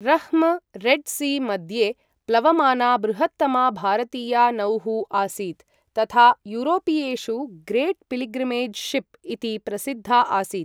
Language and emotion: Sanskrit, neutral